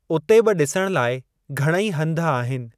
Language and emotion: Sindhi, neutral